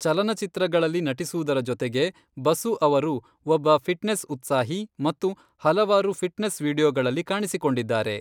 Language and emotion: Kannada, neutral